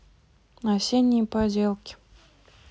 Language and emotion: Russian, neutral